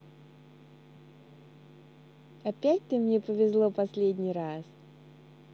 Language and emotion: Russian, neutral